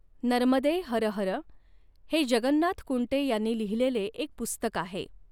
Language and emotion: Marathi, neutral